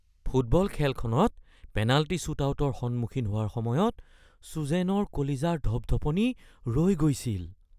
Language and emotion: Assamese, fearful